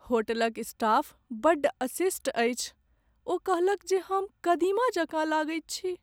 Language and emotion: Maithili, sad